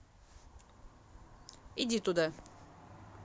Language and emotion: Russian, neutral